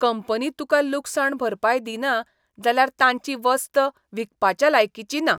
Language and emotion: Goan Konkani, disgusted